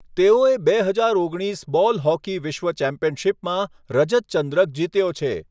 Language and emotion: Gujarati, neutral